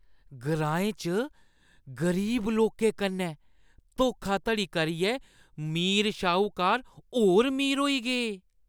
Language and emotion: Dogri, disgusted